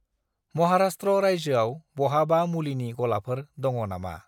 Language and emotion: Bodo, neutral